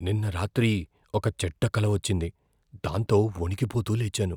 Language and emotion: Telugu, fearful